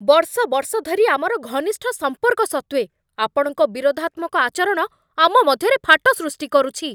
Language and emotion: Odia, angry